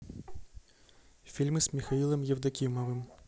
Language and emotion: Russian, neutral